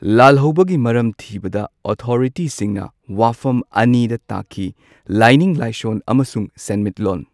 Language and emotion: Manipuri, neutral